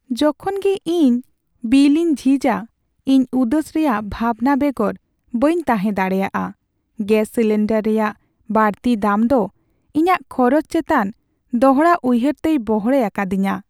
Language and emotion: Santali, sad